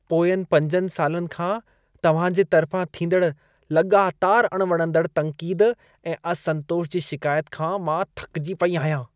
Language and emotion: Sindhi, disgusted